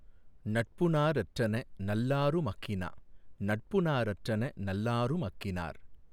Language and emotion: Tamil, neutral